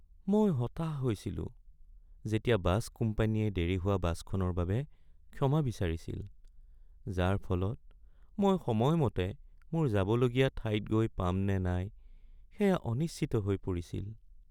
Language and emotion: Assamese, sad